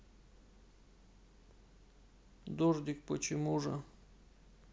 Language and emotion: Russian, sad